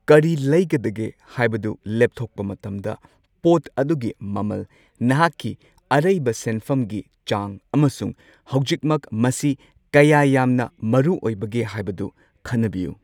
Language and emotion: Manipuri, neutral